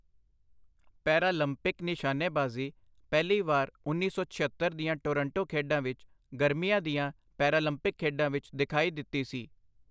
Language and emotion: Punjabi, neutral